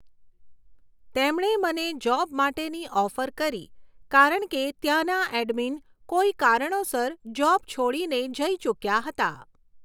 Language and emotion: Gujarati, neutral